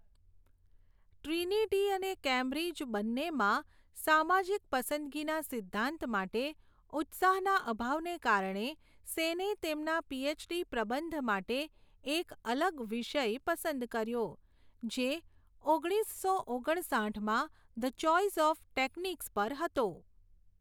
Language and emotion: Gujarati, neutral